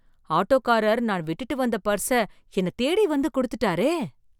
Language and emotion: Tamil, surprised